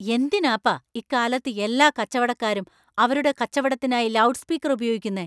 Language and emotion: Malayalam, angry